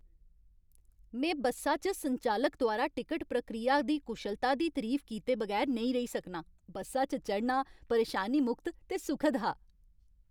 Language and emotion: Dogri, happy